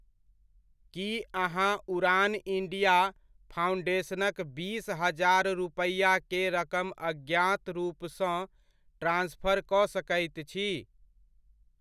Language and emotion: Maithili, neutral